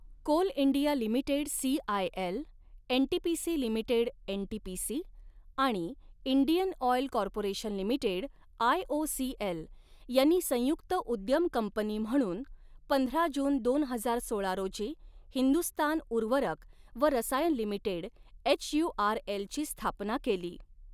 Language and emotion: Marathi, neutral